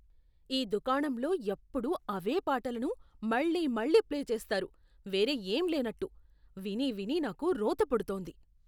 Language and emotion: Telugu, disgusted